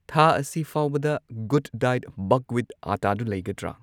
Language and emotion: Manipuri, neutral